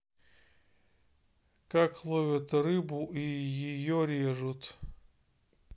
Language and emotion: Russian, neutral